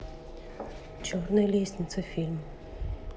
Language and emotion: Russian, neutral